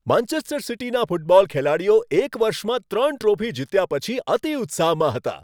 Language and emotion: Gujarati, happy